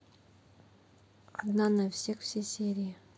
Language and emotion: Russian, neutral